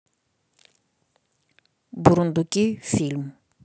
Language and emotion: Russian, neutral